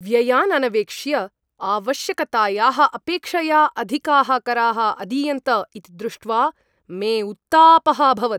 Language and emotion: Sanskrit, angry